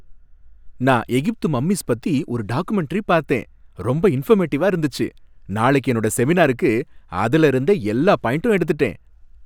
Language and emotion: Tamil, happy